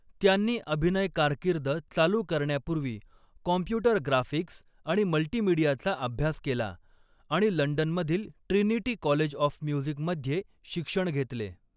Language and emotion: Marathi, neutral